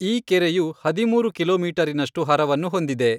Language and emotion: Kannada, neutral